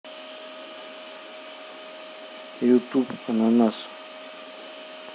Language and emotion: Russian, neutral